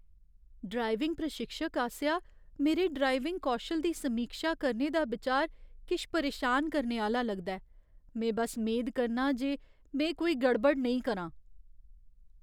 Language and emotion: Dogri, fearful